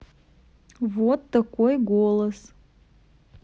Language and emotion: Russian, neutral